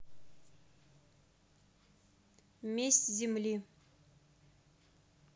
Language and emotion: Russian, neutral